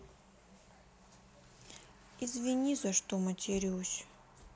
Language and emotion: Russian, sad